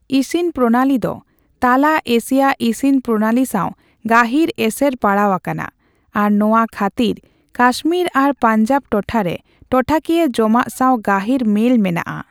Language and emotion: Santali, neutral